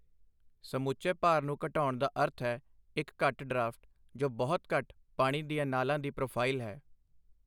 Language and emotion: Punjabi, neutral